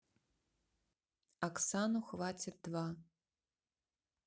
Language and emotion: Russian, neutral